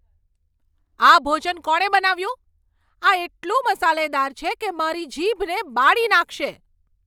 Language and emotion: Gujarati, angry